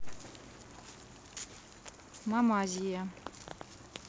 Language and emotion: Russian, neutral